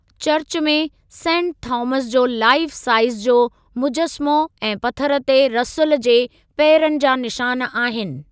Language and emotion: Sindhi, neutral